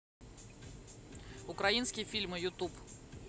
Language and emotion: Russian, neutral